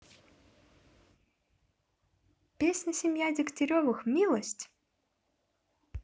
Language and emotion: Russian, neutral